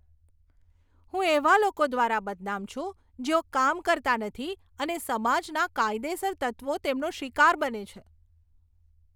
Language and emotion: Gujarati, disgusted